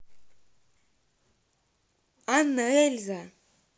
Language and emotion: Russian, neutral